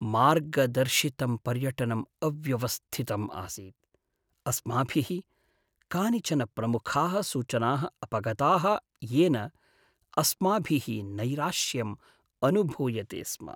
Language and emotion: Sanskrit, sad